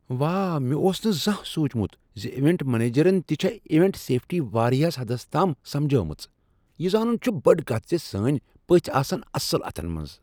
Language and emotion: Kashmiri, surprised